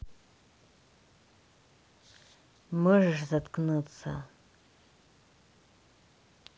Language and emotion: Russian, angry